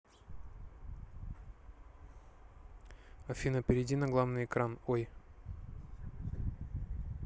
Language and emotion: Russian, neutral